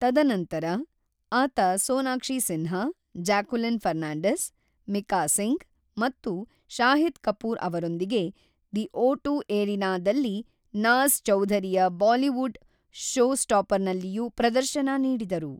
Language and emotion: Kannada, neutral